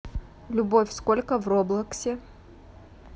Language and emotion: Russian, neutral